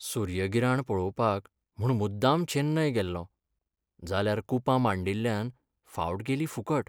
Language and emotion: Goan Konkani, sad